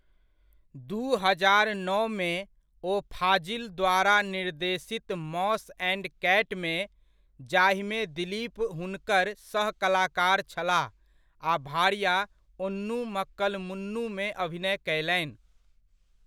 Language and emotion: Maithili, neutral